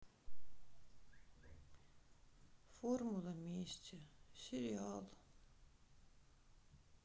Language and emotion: Russian, sad